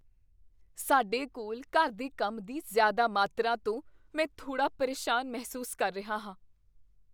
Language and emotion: Punjabi, fearful